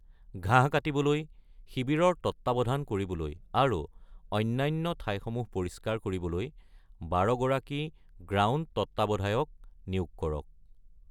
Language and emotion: Assamese, neutral